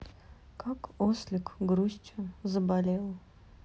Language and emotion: Russian, sad